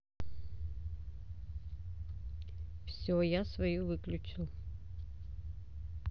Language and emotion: Russian, neutral